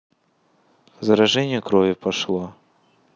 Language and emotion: Russian, neutral